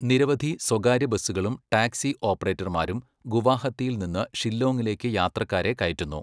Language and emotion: Malayalam, neutral